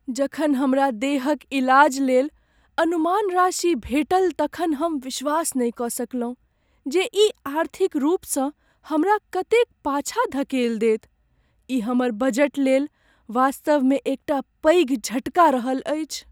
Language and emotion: Maithili, sad